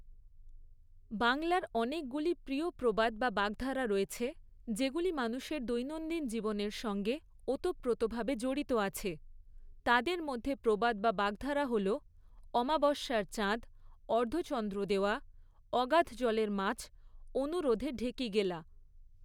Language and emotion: Bengali, neutral